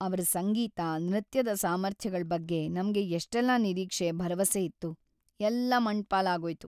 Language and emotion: Kannada, sad